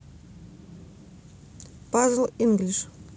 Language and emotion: Russian, neutral